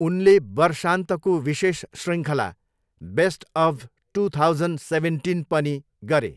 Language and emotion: Nepali, neutral